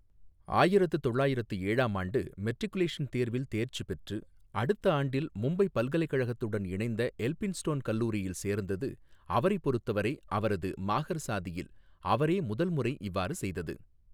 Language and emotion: Tamil, neutral